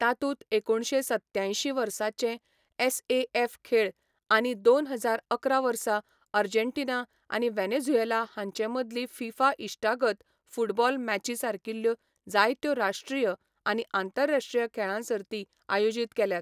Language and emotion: Goan Konkani, neutral